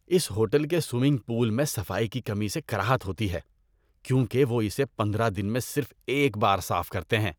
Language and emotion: Urdu, disgusted